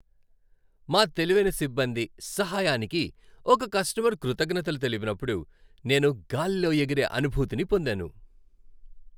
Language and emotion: Telugu, happy